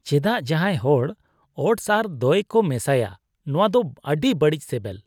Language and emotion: Santali, disgusted